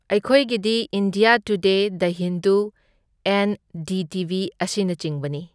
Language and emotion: Manipuri, neutral